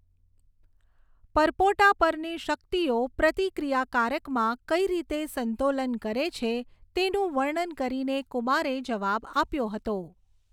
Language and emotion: Gujarati, neutral